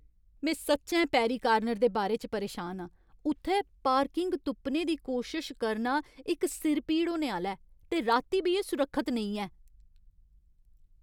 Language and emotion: Dogri, angry